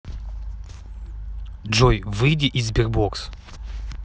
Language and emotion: Russian, neutral